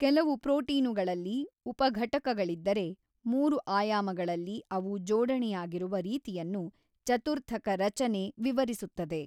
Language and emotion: Kannada, neutral